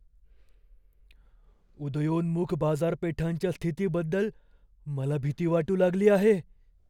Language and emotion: Marathi, fearful